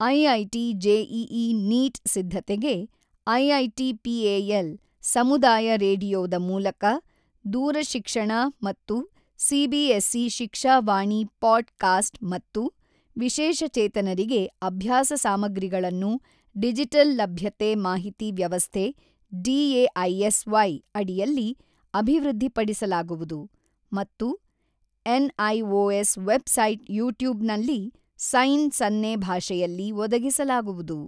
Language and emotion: Kannada, neutral